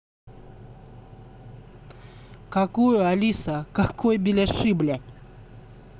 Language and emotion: Russian, angry